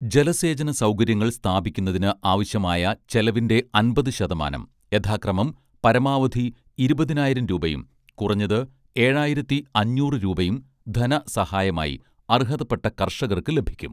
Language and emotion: Malayalam, neutral